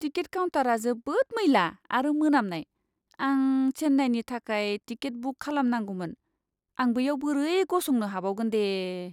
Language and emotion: Bodo, disgusted